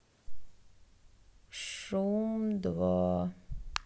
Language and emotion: Russian, sad